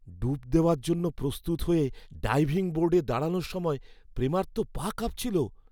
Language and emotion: Bengali, fearful